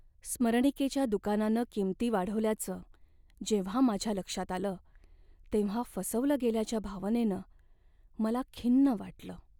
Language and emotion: Marathi, sad